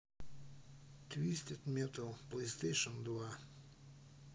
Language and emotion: Russian, neutral